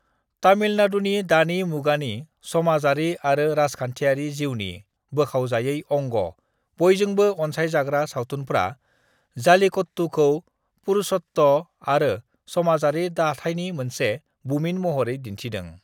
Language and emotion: Bodo, neutral